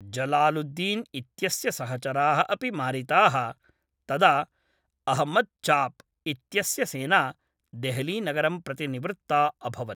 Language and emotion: Sanskrit, neutral